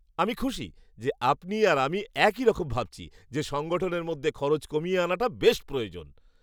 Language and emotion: Bengali, happy